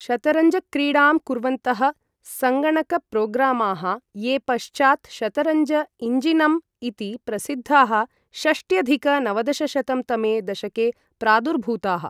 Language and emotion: Sanskrit, neutral